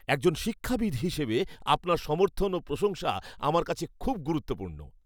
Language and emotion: Bengali, happy